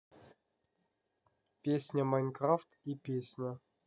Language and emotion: Russian, neutral